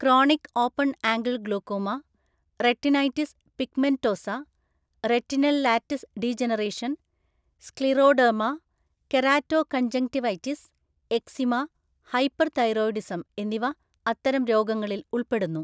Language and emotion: Malayalam, neutral